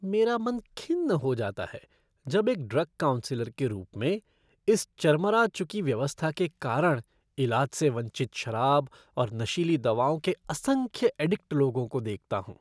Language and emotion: Hindi, disgusted